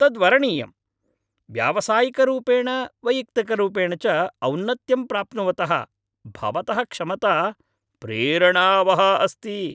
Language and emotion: Sanskrit, happy